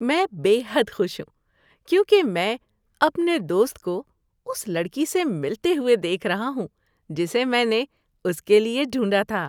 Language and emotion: Urdu, happy